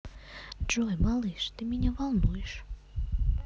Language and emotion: Russian, neutral